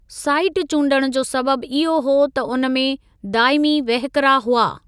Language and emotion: Sindhi, neutral